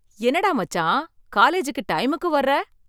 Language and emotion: Tamil, surprised